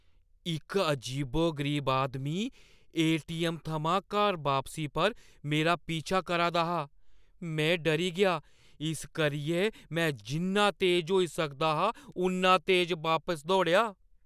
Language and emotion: Dogri, fearful